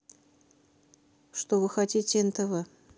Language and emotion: Russian, neutral